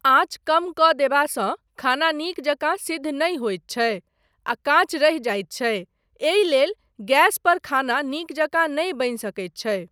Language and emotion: Maithili, neutral